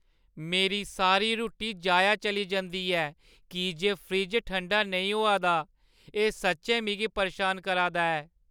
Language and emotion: Dogri, sad